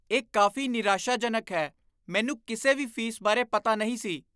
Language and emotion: Punjabi, disgusted